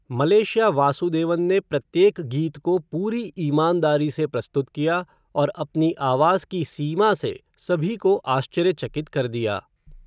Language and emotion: Hindi, neutral